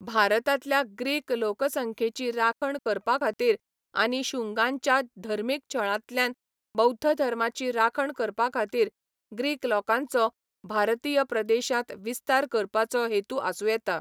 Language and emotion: Goan Konkani, neutral